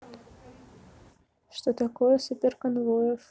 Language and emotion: Russian, neutral